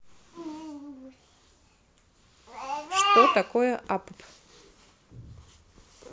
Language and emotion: Russian, neutral